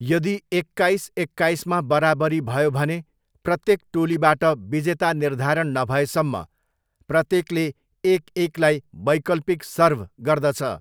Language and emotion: Nepali, neutral